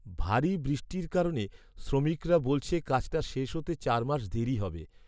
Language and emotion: Bengali, sad